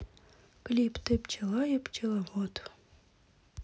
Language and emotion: Russian, neutral